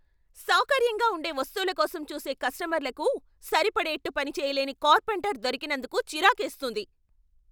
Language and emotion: Telugu, angry